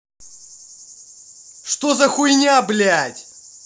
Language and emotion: Russian, angry